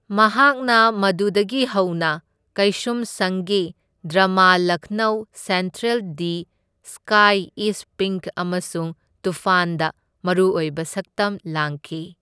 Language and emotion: Manipuri, neutral